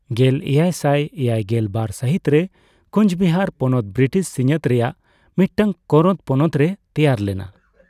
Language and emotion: Santali, neutral